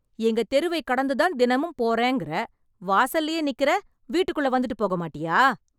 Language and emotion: Tamil, angry